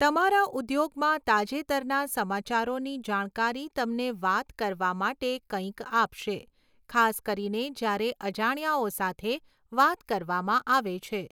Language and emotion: Gujarati, neutral